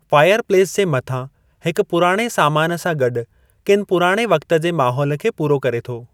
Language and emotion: Sindhi, neutral